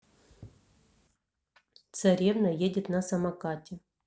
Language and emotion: Russian, neutral